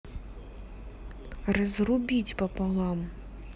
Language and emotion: Russian, neutral